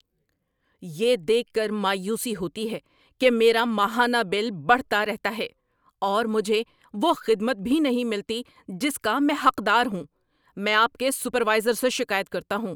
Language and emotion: Urdu, angry